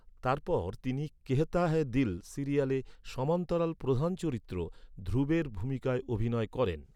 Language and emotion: Bengali, neutral